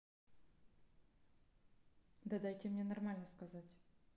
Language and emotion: Russian, neutral